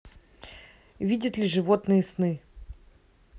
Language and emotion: Russian, neutral